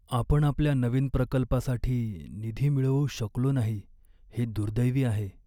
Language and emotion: Marathi, sad